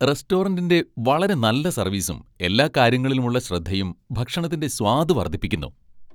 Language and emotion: Malayalam, happy